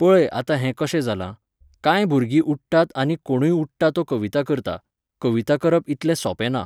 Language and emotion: Goan Konkani, neutral